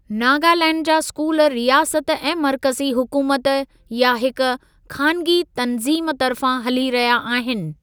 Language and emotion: Sindhi, neutral